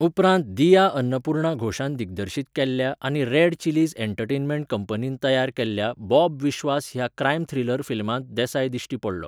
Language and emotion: Goan Konkani, neutral